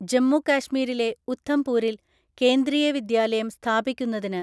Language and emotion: Malayalam, neutral